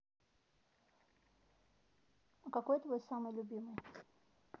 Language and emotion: Russian, neutral